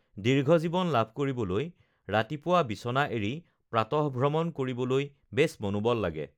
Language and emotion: Assamese, neutral